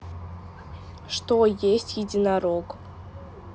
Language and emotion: Russian, neutral